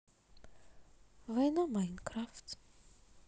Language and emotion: Russian, sad